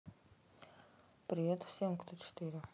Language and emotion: Russian, neutral